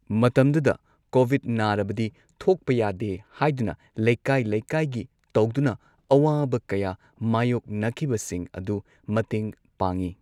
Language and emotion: Manipuri, neutral